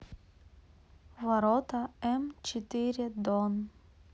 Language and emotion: Russian, neutral